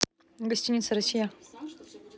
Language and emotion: Russian, neutral